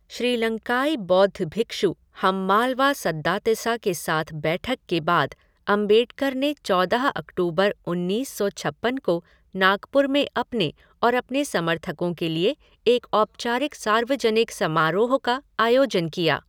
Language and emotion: Hindi, neutral